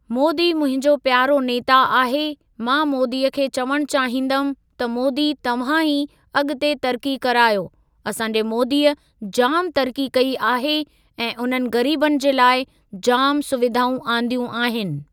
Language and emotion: Sindhi, neutral